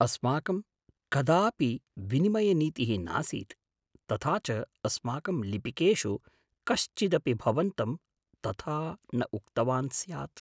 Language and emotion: Sanskrit, surprised